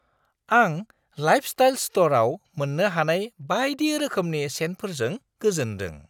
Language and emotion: Bodo, surprised